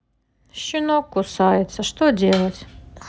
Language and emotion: Russian, sad